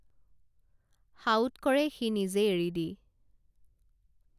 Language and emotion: Assamese, neutral